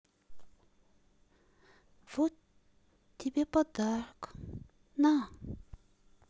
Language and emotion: Russian, sad